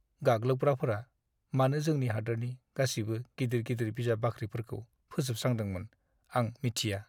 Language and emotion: Bodo, sad